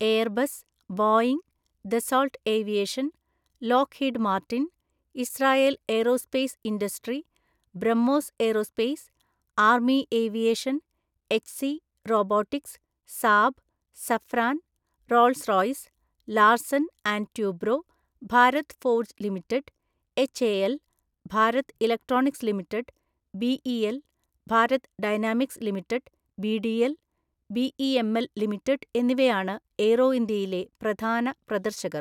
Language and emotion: Malayalam, neutral